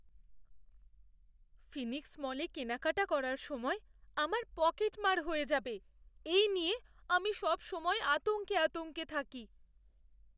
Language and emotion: Bengali, fearful